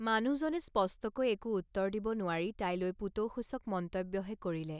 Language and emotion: Assamese, neutral